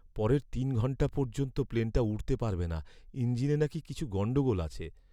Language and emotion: Bengali, sad